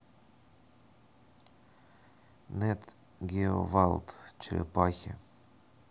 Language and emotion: Russian, neutral